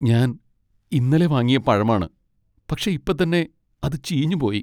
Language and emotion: Malayalam, sad